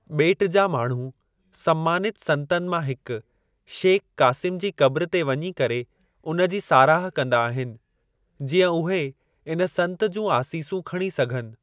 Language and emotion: Sindhi, neutral